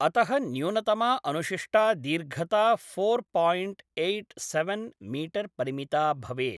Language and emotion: Sanskrit, neutral